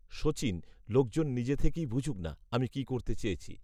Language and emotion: Bengali, neutral